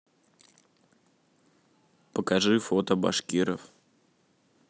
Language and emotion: Russian, neutral